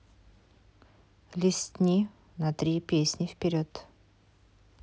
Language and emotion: Russian, neutral